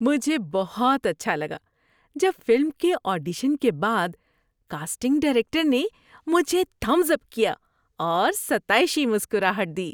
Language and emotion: Urdu, happy